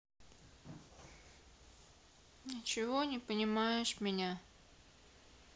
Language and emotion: Russian, sad